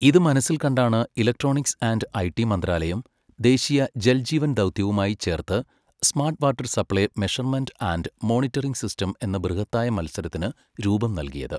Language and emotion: Malayalam, neutral